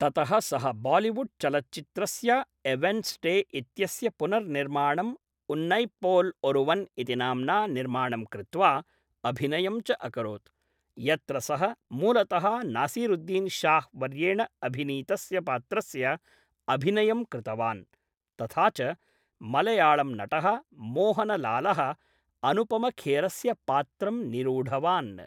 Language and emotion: Sanskrit, neutral